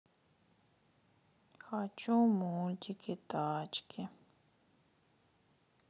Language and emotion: Russian, sad